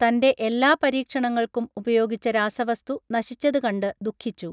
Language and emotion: Malayalam, neutral